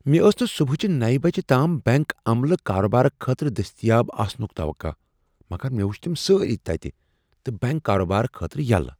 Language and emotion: Kashmiri, surprised